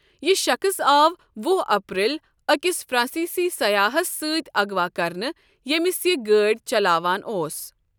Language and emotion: Kashmiri, neutral